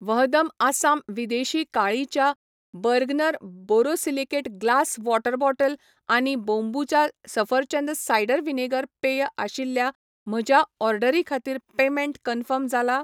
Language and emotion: Goan Konkani, neutral